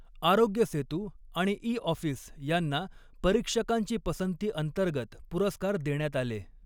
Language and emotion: Marathi, neutral